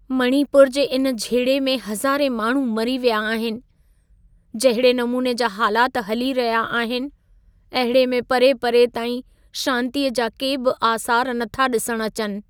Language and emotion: Sindhi, sad